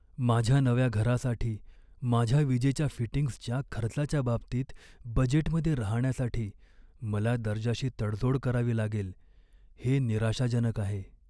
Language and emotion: Marathi, sad